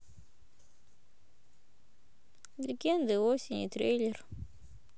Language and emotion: Russian, neutral